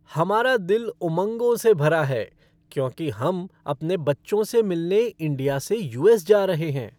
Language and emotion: Hindi, happy